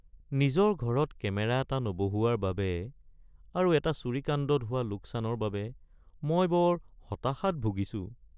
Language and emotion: Assamese, sad